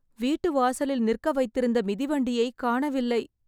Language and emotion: Tamil, sad